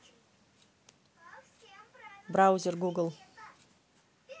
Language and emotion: Russian, neutral